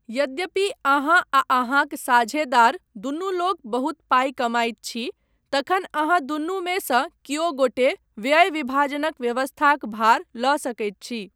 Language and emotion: Maithili, neutral